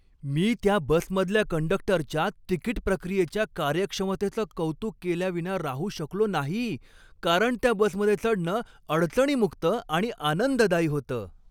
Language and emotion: Marathi, happy